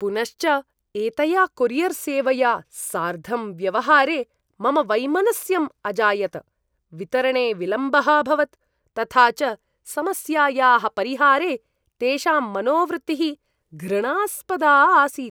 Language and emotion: Sanskrit, disgusted